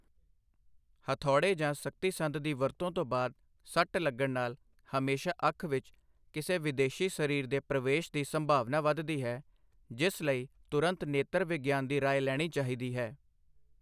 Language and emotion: Punjabi, neutral